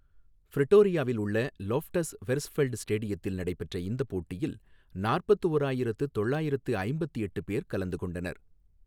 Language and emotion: Tamil, neutral